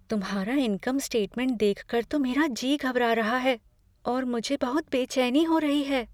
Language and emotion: Hindi, fearful